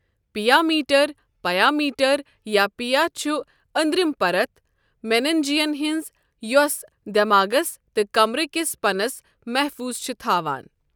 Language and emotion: Kashmiri, neutral